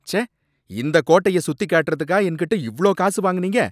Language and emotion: Tamil, angry